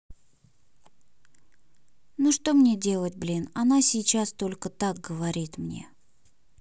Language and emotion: Russian, sad